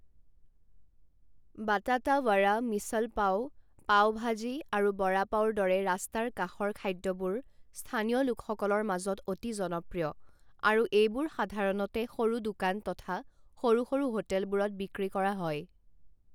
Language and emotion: Assamese, neutral